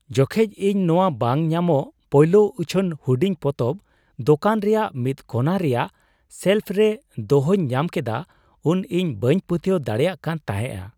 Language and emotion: Santali, surprised